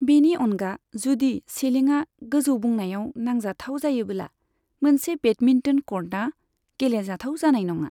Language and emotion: Bodo, neutral